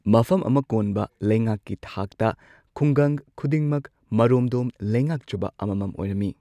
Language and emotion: Manipuri, neutral